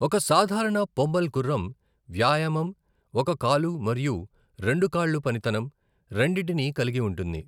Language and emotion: Telugu, neutral